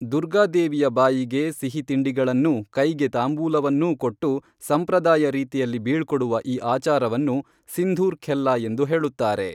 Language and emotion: Kannada, neutral